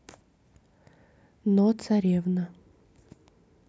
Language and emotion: Russian, neutral